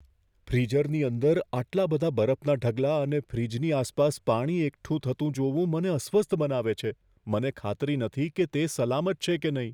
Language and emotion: Gujarati, fearful